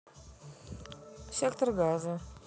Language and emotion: Russian, neutral